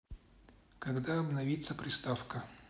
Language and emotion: Russian, neutral